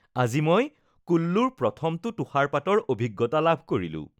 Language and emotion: Assamese, happy